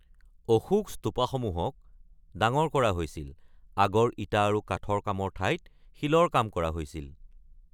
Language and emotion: Assamese, neutral